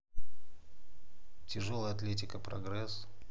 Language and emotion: Russian, neutral